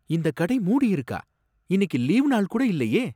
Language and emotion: Tamil, surprised